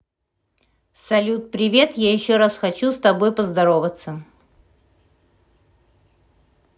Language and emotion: Russian, positive